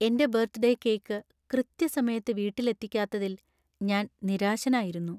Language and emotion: Malayalam, sad